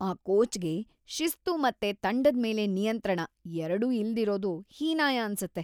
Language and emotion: Kannada, disgusted